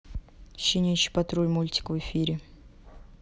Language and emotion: Russian, neutral